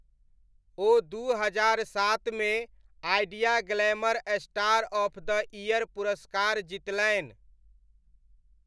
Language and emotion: Maithili, neutral